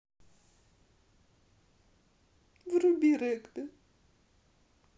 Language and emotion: Russian, sad